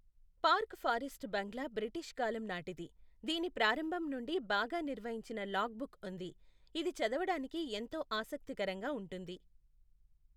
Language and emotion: Telugu, neutral